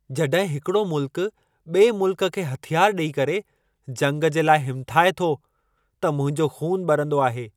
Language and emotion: Sindhi, angry